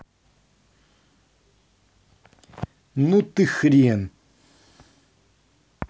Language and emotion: Russian, angry